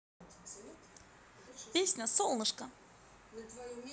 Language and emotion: Russian, positive